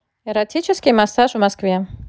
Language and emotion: Russian, neutral